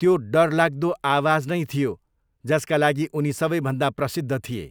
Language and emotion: Nepali, neutral